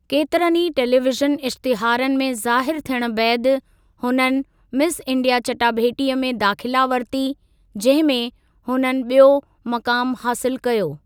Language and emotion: Sindhi, neutral